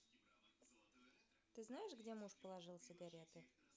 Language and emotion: Russian, neutral